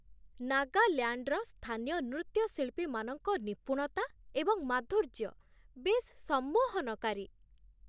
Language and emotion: Odia, surprised